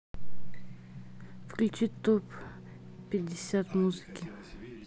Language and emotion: Russian, neutral